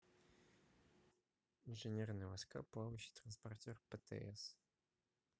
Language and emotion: Russian, neutral